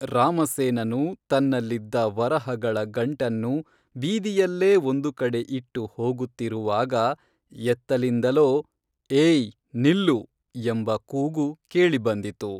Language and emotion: Kannada, neutral